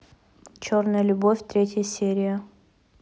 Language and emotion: Russian, neutral